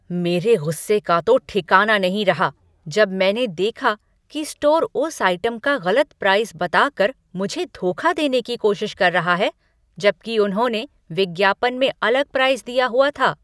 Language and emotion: Hindi, angry